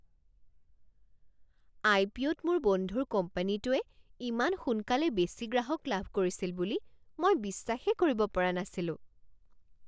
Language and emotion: Assamese, surprised